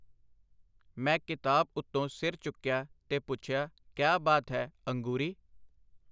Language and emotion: Punjabi, neutral